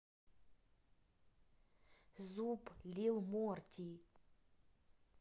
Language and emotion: Russian, neutral